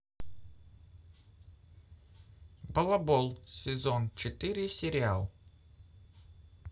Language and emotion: Russian, neutral